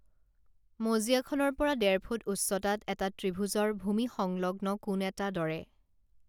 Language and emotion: Assamese, neutral